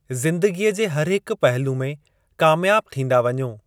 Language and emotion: Sindhi, neutral